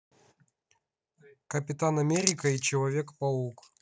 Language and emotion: Russian, neutral